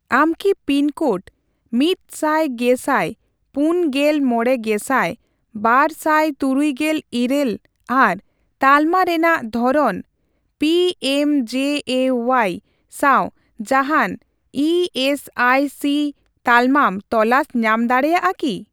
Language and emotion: Santali, neutral